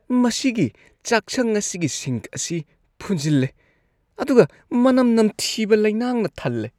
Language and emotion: Manipuri, disgusted